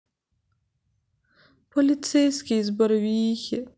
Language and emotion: Russian, sad